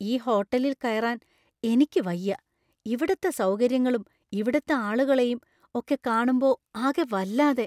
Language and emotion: Malayalam, fearful